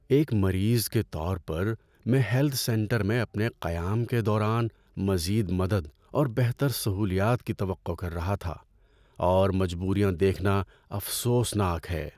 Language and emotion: Urdu, sad